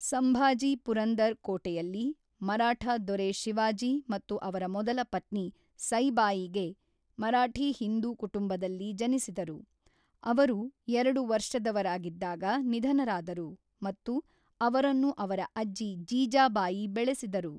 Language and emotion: Kannada, neutral